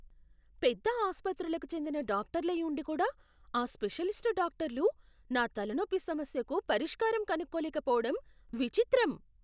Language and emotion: Telugu, surprised